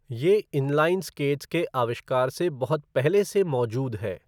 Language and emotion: Hindi, neutral